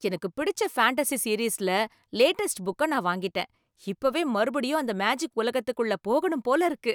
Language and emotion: Tamil, happy